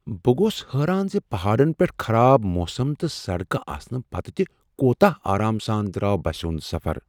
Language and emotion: Kashmiri, surprised